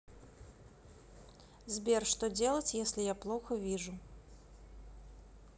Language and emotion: Russian, neutral